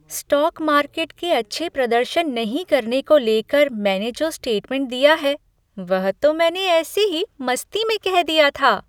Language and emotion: Hindi, happy